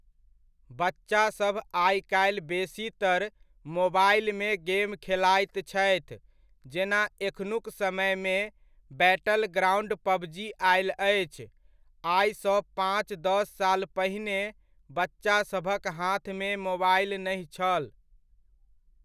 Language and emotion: Maithili, neutral